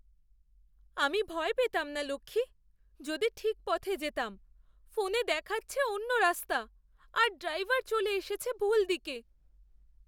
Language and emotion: Bengali, fearful